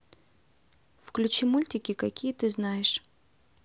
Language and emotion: Russian, neutral